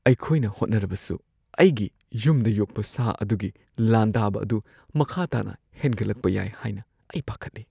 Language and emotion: Manipuri, fearful